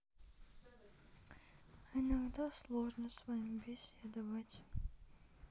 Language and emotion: Russian, sad